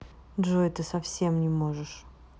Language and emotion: Russian, neutral